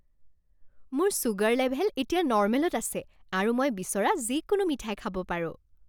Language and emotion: Assamese, happy